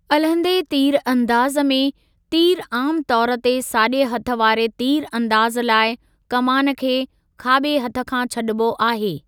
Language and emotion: Sindhi, neutral